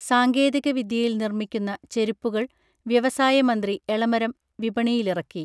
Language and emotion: Malayalam, neutral